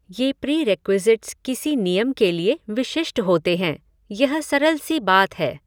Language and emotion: Hindi, neutral